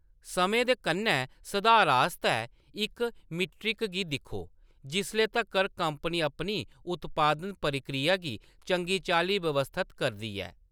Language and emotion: Dogri, neutral